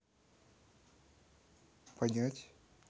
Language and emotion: Russian, neutral